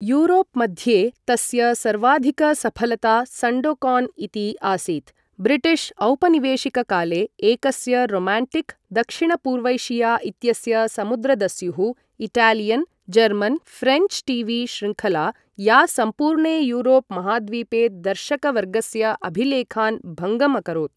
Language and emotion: Sanskrit, neutral